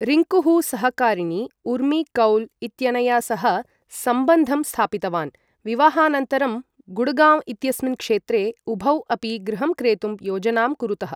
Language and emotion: Sanskrit, neutral